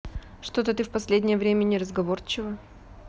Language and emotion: Russian, neutral